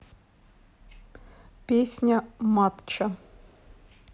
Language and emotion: Russian, neutral